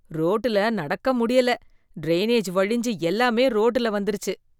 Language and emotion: Tamil, disgusted